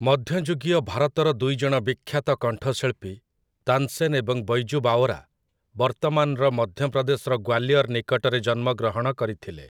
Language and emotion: Odia, neutral